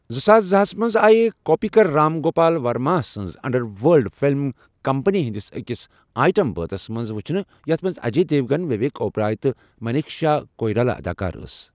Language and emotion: Kashmiri, neutral